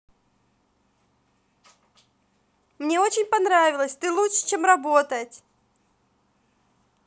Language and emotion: Russian, positive